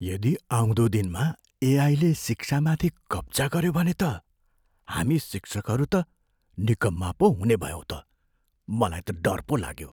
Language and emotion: Nepali, fearful